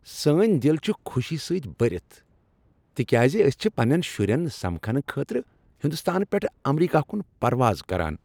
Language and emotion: Kashmiri, happy